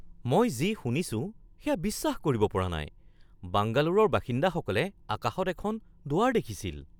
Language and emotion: Assamese, surprised